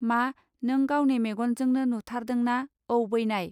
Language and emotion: Bodo, neutral